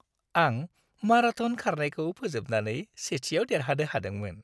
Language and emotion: Bodo, happy